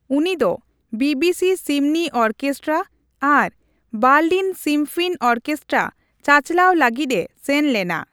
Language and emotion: Santali, neutral